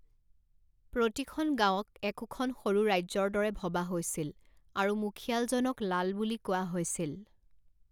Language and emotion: Assamese, neutral